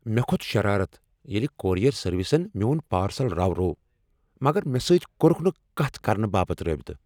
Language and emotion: Kashmiri, angry